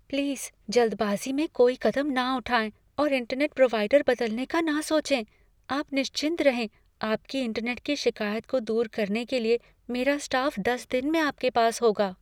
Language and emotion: Hindi, fearful